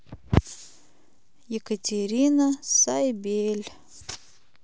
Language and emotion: Russian, neutral